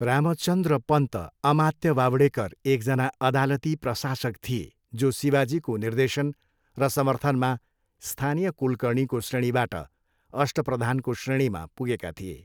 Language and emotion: Nepali, neutral